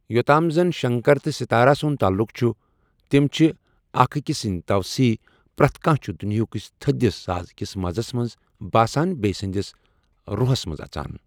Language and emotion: Kashmiri, neutral